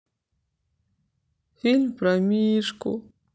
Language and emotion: Russian, sad